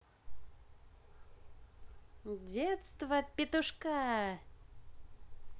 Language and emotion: Russian, positive